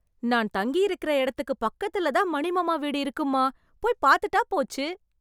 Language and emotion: Tamil, happy